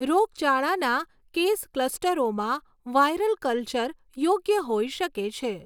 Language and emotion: Gujarati, neutral